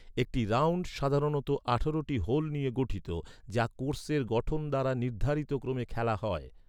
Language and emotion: Bengali, neutral